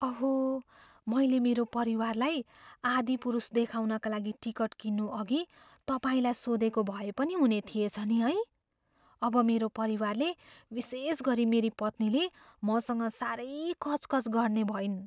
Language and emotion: Nepali, fearful